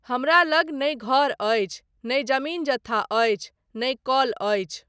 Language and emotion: Maithili, neutral